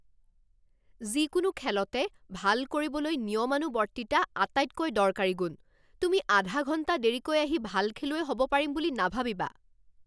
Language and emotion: Assamese, angry